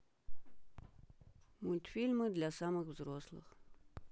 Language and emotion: Russian, neutral